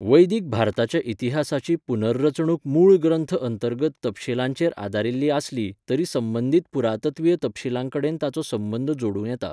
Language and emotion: Goan Konkani, neutral